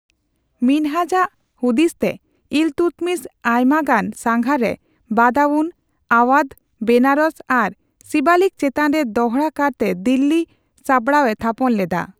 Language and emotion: Santali, neutral